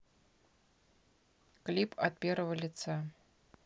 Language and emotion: Russian, neutral